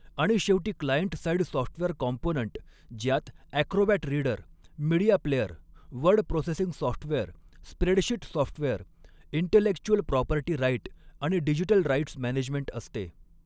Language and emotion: Marathi, neutral